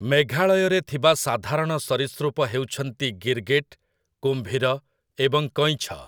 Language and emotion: Odia, neutral